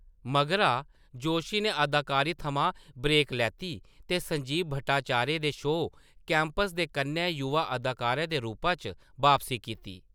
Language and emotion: Dogri, neutral